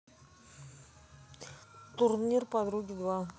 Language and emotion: Russian, neutral